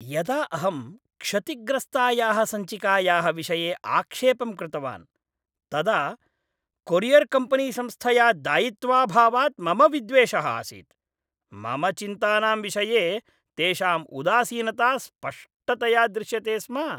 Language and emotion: Sanskrit, disgusted